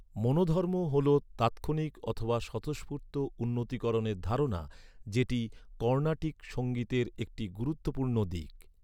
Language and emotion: Bengali, neutral